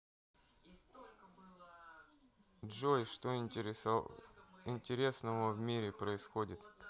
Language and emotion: Russian, neutral